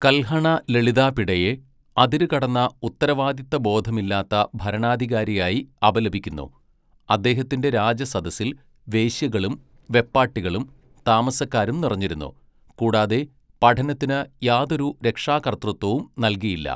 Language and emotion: Malayalam, neutral